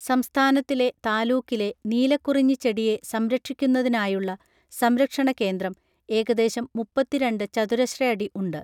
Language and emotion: Malayalam, neutral